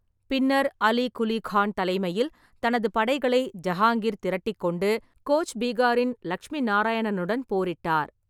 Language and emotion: Tamil, neutral